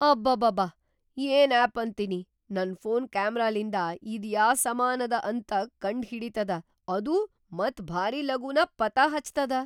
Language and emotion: Kannada, surprised